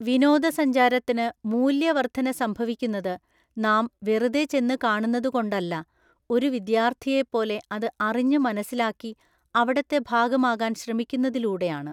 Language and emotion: Malayalam, neutral